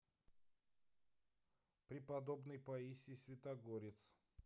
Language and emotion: Russian, neutral